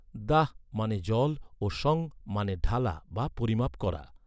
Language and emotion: Bengali, neutral